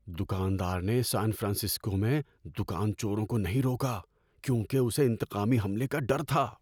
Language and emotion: Urdu, fearful